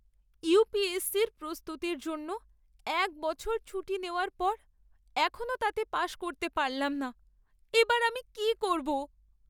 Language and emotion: Bengali, sad